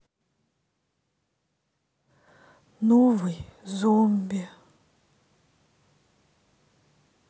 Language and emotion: Russian, sad